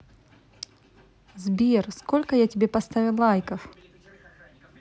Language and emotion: Russian, positive